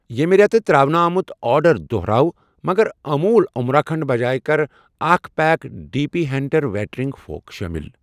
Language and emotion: Kashmiri, neutral